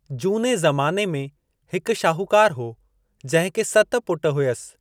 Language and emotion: Sindhi, neutral